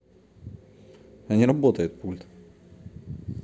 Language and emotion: Russian, neutral